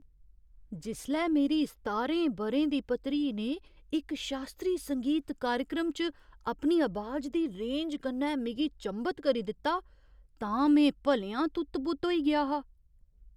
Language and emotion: Dogri, surprised